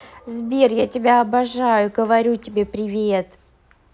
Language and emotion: Russian, positive